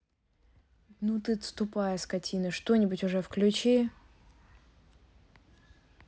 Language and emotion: Russian, angry